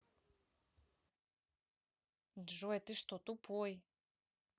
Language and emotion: Russian, angry